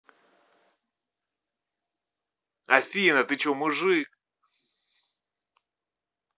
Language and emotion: Russian, angry